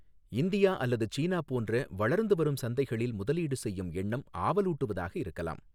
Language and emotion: Tamil, neutral